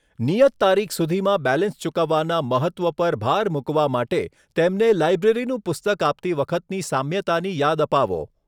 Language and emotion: Gujarati, neutral